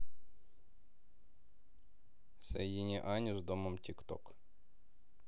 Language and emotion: Russian, neutral